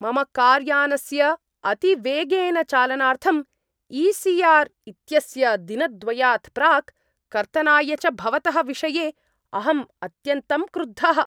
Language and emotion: Sanskrit, angry